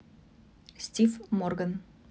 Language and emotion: Russian, neutral